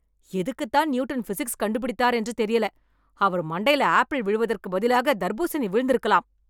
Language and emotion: Tamil, angry